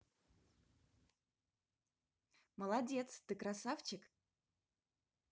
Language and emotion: Russian, positive